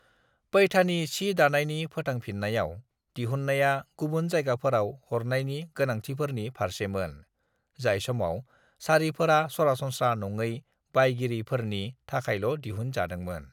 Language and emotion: Bodo, neutral